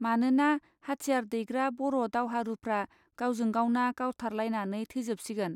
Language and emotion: Bodo, neutral